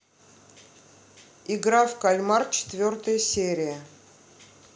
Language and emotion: Russian, neutral